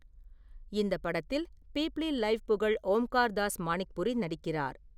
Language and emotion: Tamil, neutral